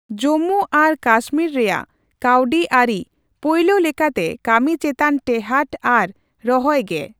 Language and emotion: Santali, neutral